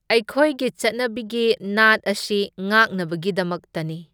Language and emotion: Manipuri, neutral